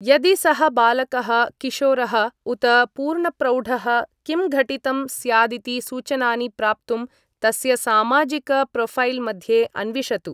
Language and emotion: Sanskrit, neutral